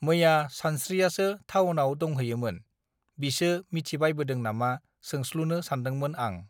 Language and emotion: Bodo, neutral